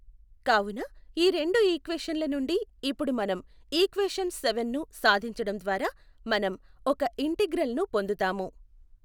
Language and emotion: Telugu, neutral